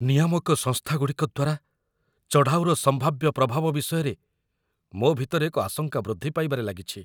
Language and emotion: Odia, fearful